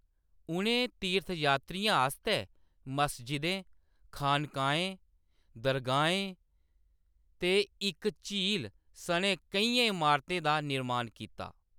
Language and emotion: Dogri, neutral